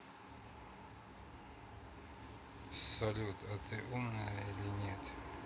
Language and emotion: Russian, neutral